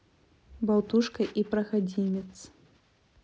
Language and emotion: Russian, neutral